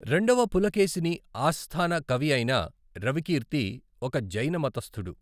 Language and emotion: Telugu, neutral